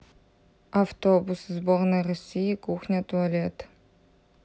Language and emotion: Russian, neutral